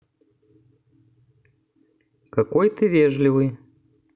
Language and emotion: Russian, neutral